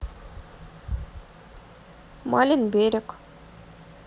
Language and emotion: Russian, neutral